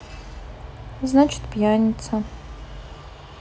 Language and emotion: Russian, neutral